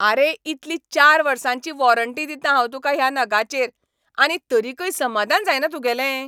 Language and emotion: Goan Konkani, angry